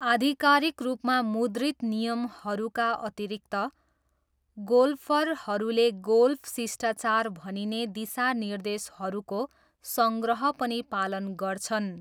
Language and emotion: Nepali, neutral